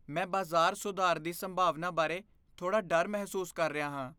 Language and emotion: Punjabi, fearful